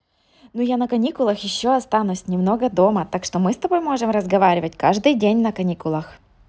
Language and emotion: Russian, positive